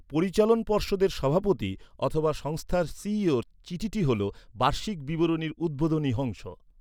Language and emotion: Bengali, neutral